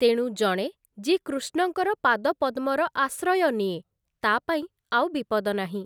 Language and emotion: Odia, neutral